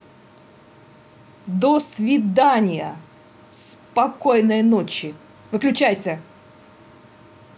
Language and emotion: Russian, angry